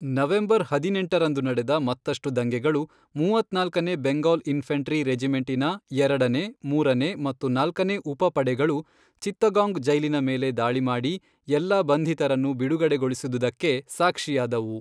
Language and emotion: Kannada, neutral